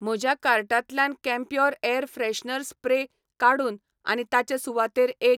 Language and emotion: Goan Konkani, neutral